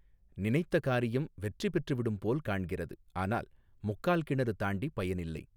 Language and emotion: Tamil, neutral